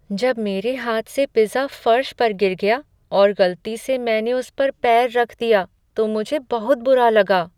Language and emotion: Hindi, sad